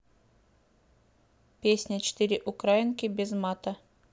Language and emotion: Russian, neutral